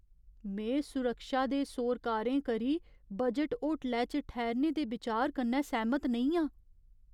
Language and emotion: Dogri, fearful